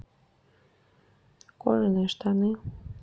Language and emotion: Russian, neutral